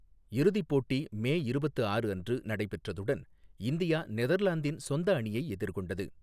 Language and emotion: Tamil, neutral